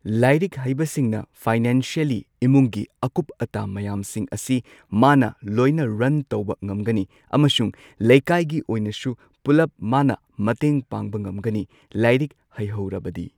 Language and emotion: Manipuri, neutral